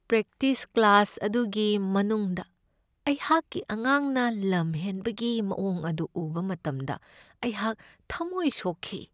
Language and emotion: Manipuri, sad